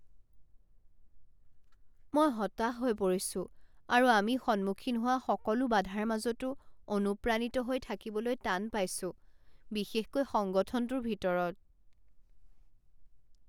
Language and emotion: Assamese, sad